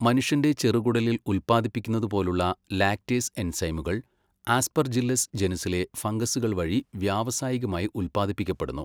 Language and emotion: Malayalam, neutral